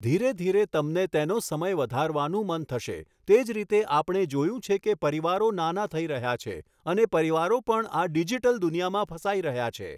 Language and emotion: Gujarati, neutral